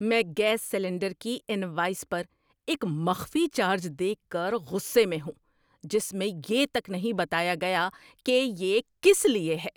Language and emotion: Urdu, angry